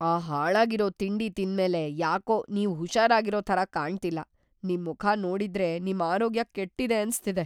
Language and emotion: Kannada, fearful